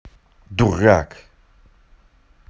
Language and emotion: Russian, angry